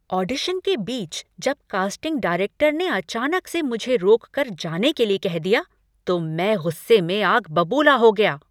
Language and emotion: Hindi, angry